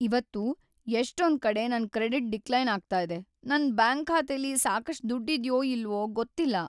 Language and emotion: Kannada, sad